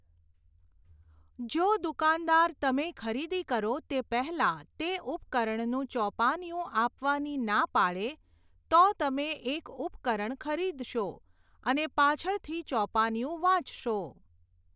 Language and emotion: Gujarati, neutral